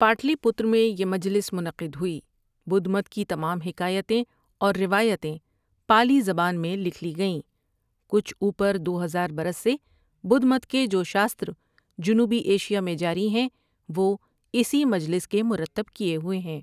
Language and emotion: Urdu, neutral